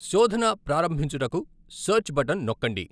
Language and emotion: Telugu, neutral